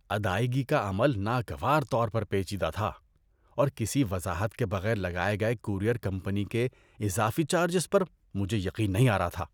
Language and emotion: Urdu, disgusted